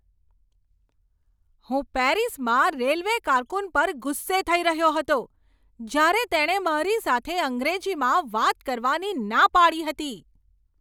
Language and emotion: Gujarati, angry